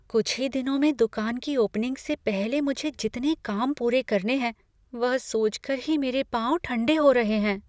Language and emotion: Hindi, fearful